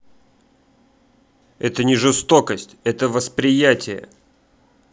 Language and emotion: Russian, angry